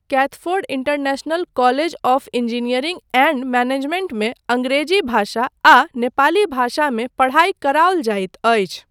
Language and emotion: Maithili, neutral